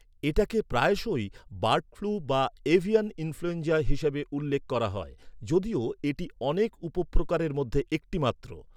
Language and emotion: Bengali, neutral